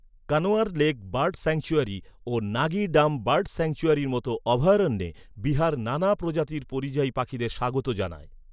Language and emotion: Bengali, neutral